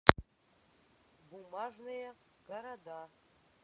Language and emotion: Russian, neutral